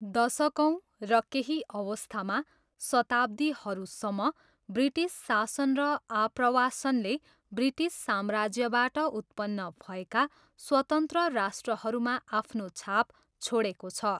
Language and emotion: Nepali, neutral